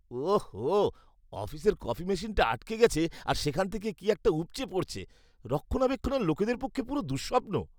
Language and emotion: Bengali, disgusted